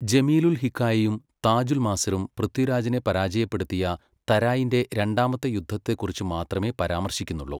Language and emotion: Malayalam, neutral